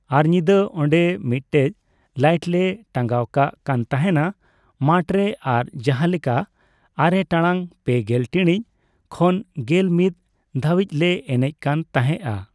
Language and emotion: Santali, neutral